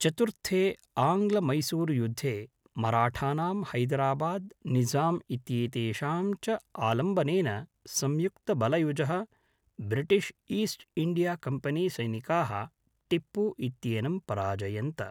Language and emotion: Sanskrit, neutral